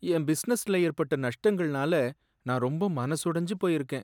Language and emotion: Tamil, sad